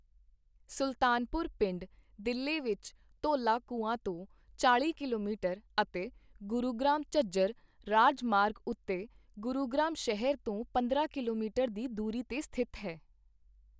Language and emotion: Punjabi, neutral